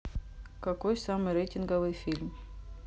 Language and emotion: Russian, neutral